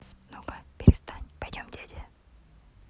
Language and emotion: Russian, neutral